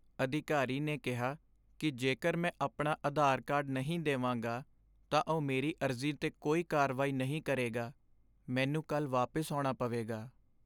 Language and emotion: Punjabi, sad